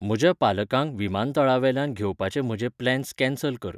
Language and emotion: Goan Konkani, neutral